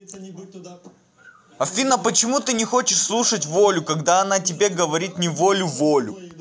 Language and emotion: Russian, angry